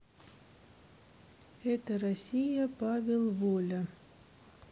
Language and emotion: Russian, neutral